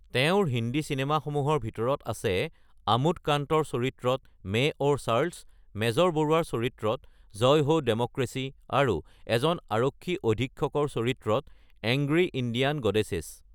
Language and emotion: Assamese, neutral